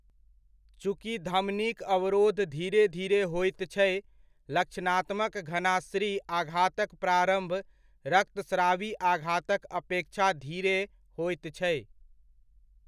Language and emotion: Maithili, neutral